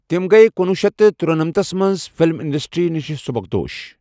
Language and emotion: Kashmiri, neutral